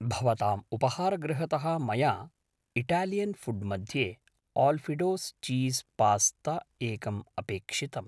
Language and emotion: Sanskrit, neutral